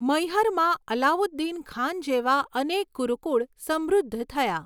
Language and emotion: Gujarati, neutral